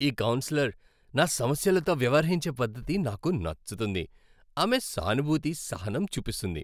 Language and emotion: Telugu, happy